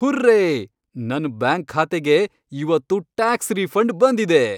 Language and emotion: Kannada, happy